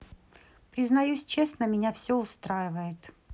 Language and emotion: Russian, neutral